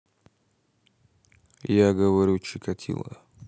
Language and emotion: Russian, neutral